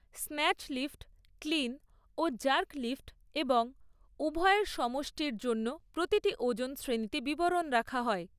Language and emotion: Bengali, neutral